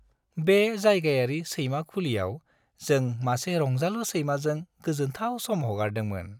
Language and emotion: Bodo, happy